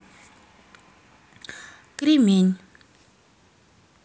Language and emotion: Russian, neutral